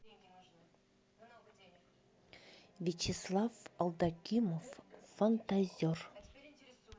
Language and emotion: Russian, neutral